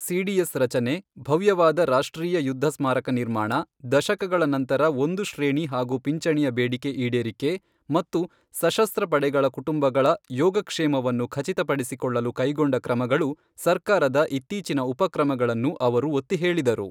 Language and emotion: Kannada, neutral